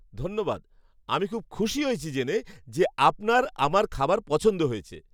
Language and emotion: Bengali, surprised